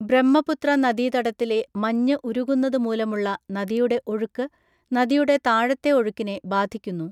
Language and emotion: Malayalam, neutral